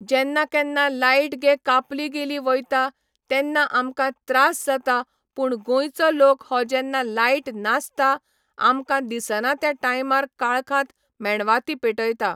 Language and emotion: Goan Konkani, neutral